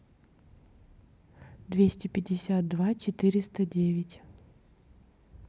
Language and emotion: Russian, neutral